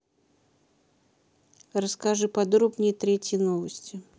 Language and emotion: Russian, neutral